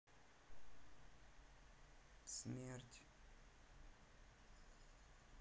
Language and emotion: Russian, sad